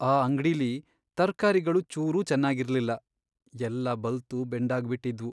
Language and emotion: Kannada, sad